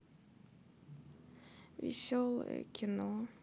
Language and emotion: Russian, sad